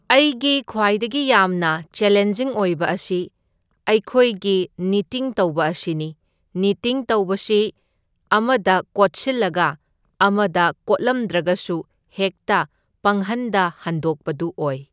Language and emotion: Manipuri, neutral